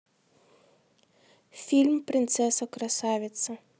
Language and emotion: Russian, neutral